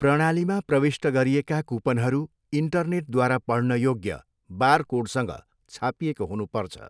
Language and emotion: Nepali, neutral